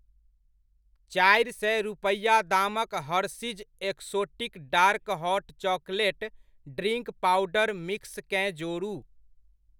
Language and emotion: Maithili, neutral